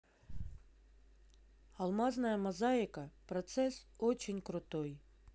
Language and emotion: Russian, neutral